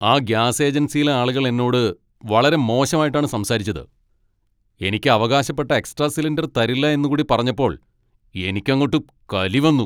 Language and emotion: Malayalam, angry